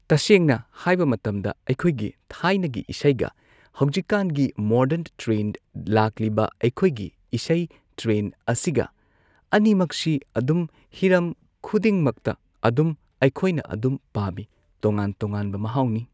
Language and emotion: Manipuri, neutral